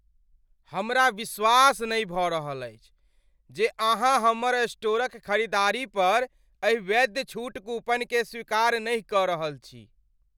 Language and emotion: Maithili, angry